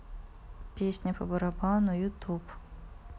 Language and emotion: Russian, neutral